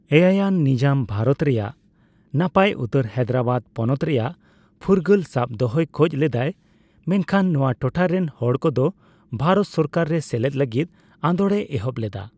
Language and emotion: Santali, neutral